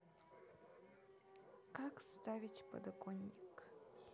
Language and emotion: Russian, sad